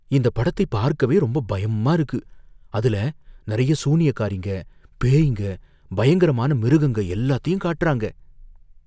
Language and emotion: Tamil, fearful